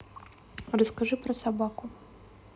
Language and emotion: Russian, neutral